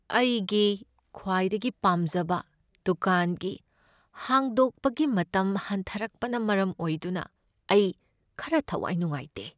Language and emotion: Manipuri, sad